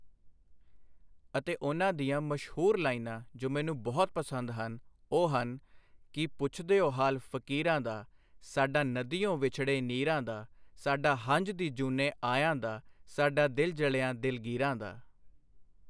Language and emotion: Punjabi, neutral